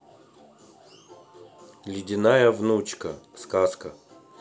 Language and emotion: Russian, neutral